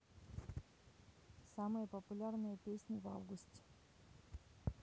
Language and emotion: Russian, neutral